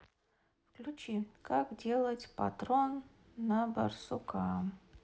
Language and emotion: Russian, neutral